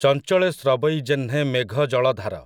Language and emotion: Odia, neutral